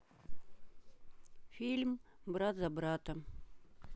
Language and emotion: Russian, neutral